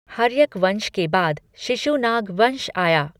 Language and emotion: Hindi, neutral